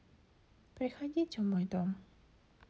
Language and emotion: Russian, sad